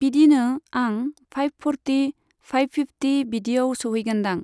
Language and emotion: Bodo, neutral